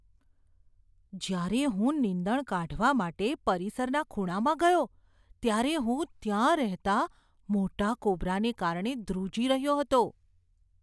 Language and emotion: Gujarati, fearful